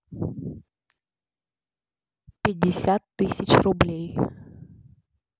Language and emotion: Russian, neutral